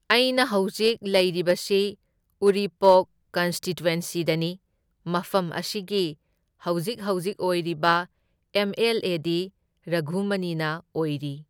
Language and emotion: Manipuri, neutral